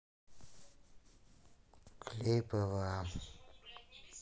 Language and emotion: Russian, neutral